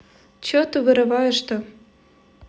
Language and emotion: Russian, angry